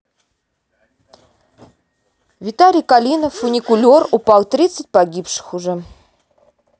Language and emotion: Russian, neutral